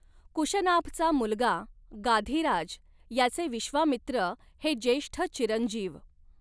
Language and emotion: Marathi, neutral